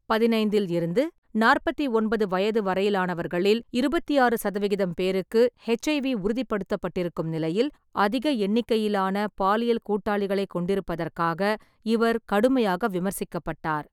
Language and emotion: Tamil, neutral